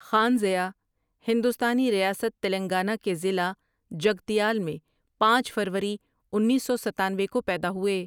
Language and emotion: Urdu, neutral